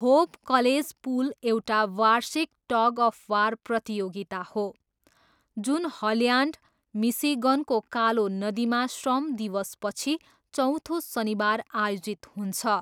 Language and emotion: Nepali, neutral